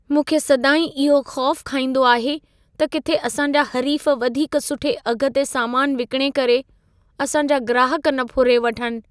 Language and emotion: Sindhi, fearful